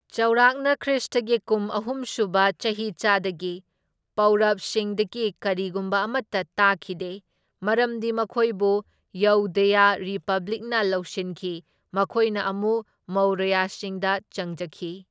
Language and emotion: Manipuri, neutral